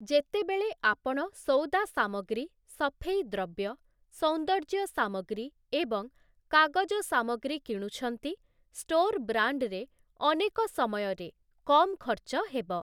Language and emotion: Odia, neutral